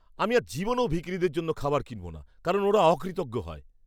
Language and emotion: Bengali, disgusted